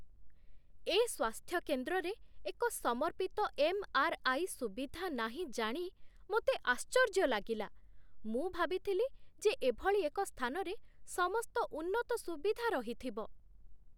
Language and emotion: Odia, surprised